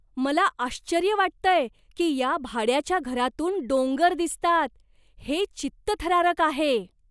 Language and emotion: Marathi, surprised